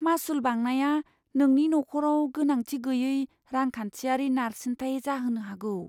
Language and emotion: Bodo, fearful